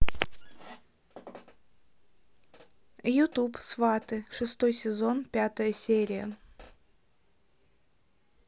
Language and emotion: Russian, neutral